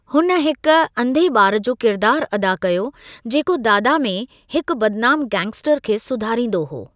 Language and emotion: Sindhi, neutral